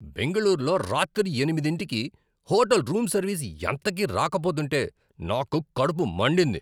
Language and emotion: Telugu, angry